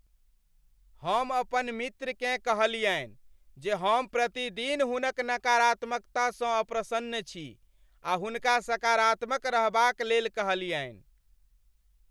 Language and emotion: Maithili, angry